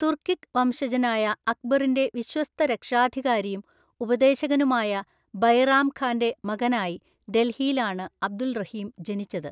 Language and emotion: Malayalam, neutral